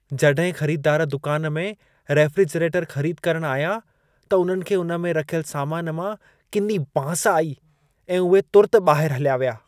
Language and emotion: Sindhi, disgusted